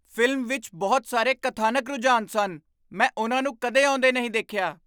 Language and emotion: Punjabi, surprised